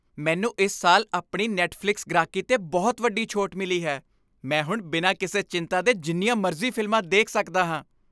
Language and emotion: Punjabi, happy